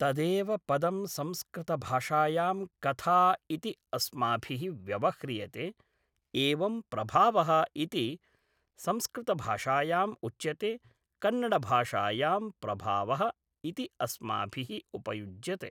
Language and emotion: Sanskrit, neutral